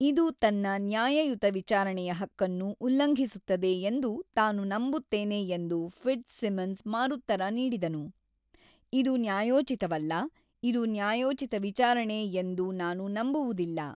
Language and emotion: Kannada, neutral